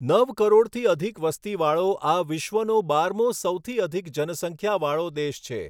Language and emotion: Gujarati, neutral